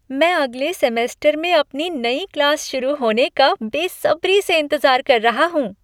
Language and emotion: Hindi, happy